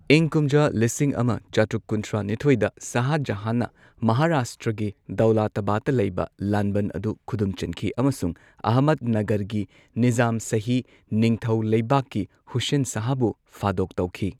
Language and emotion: Manipuri, neutral